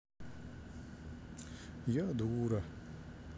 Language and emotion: Russian, sad